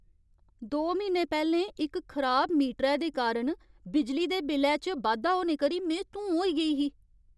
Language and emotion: Dogri, angry